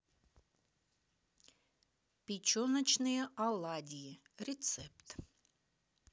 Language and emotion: Russian, neutral